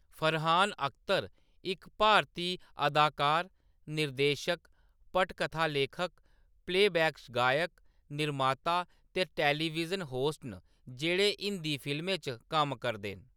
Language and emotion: Dogri, neutral